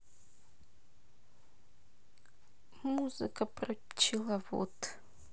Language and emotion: Russian, sad